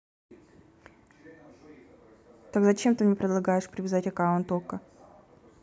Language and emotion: Russian, angry